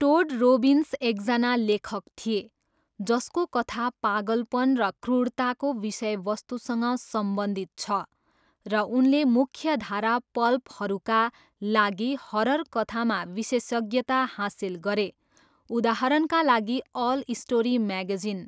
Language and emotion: Nepali, neutral